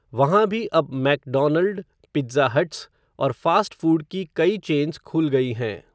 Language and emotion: Hindi, neutral